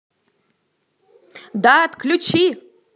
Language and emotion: Russian, angry